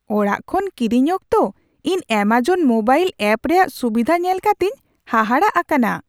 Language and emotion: Santali, surprised